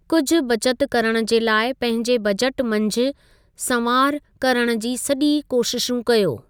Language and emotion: Sindhi, neutral